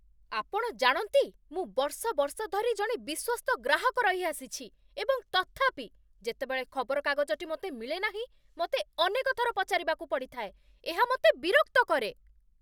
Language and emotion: Odia, angry